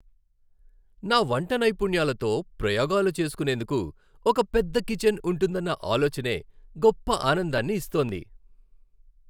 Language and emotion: Telugu, happy